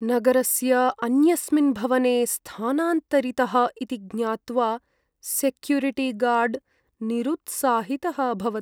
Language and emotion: Sanskrit, sad